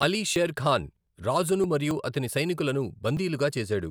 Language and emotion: Telugu, neutral